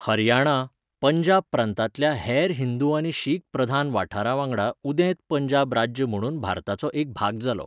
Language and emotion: Goan Konkani, neutral